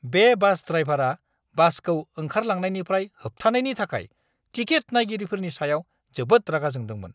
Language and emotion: Bodo, angry